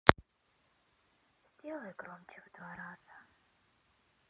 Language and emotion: Russian, sad